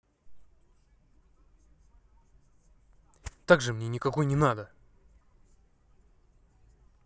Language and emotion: Russian, angry